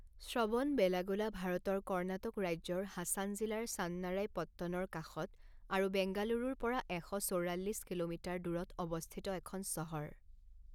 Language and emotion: Assamese, neutral